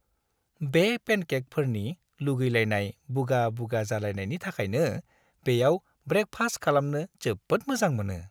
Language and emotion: Bodo, happy